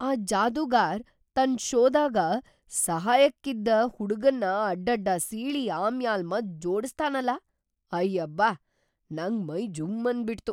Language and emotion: Kannada, surprised